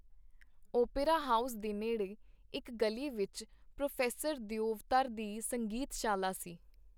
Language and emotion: Punjabi, neutral